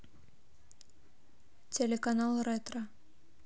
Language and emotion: Russian, neutral